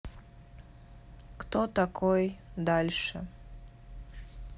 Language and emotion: Russian, neutral